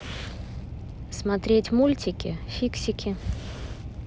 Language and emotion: Russian, neutral